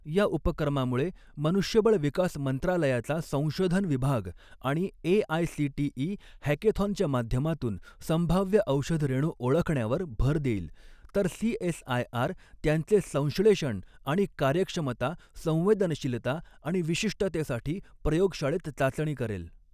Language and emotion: Marathi, neutral